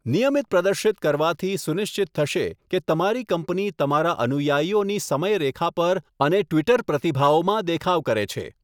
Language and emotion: Gujarati, neutral